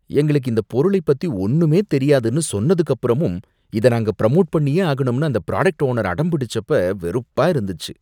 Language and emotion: Tamil, disgusted